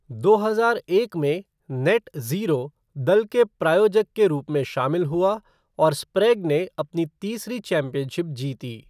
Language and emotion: Hindi, neutral